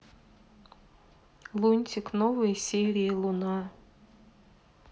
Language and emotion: Russian, neutral